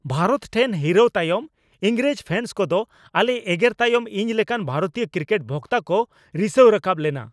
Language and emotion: Santali, angry